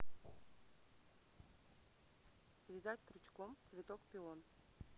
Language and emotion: Russian, neutral